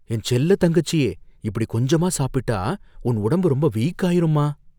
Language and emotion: Tamil, fearful